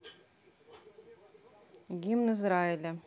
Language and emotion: Russian, neutral